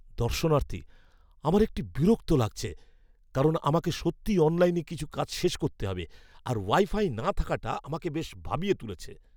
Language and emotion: Bengali, fearful